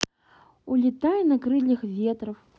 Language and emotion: Russian, neutral